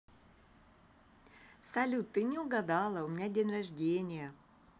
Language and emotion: Russian, positive